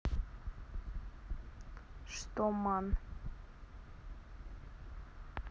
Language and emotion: Russian, neutral